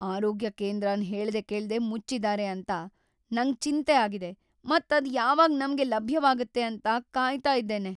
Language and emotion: Kannada, fearful